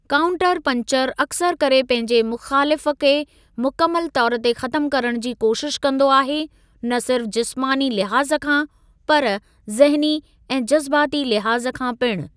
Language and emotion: Sindhi, neutral